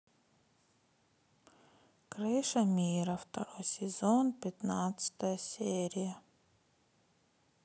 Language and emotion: Russian, sad